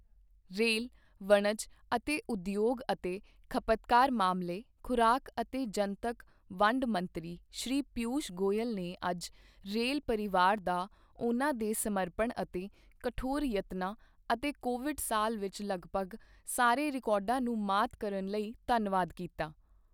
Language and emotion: Punjabi, neutral